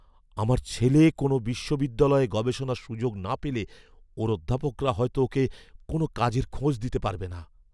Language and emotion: Bengali, fearful